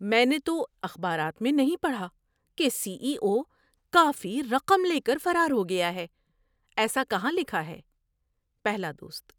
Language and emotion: Urdu, surprised